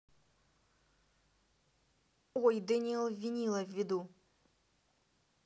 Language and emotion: Russian, neutral